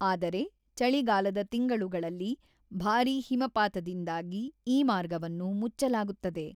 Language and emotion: Kannada, neutral